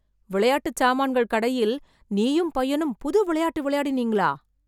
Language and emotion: Tamil, surprised